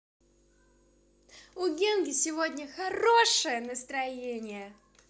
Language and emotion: Russian, positive